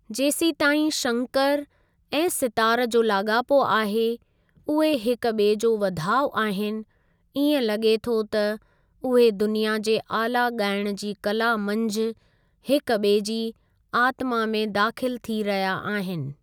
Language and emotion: Sindhi, neutral